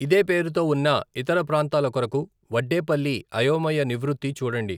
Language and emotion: Telugu, neutral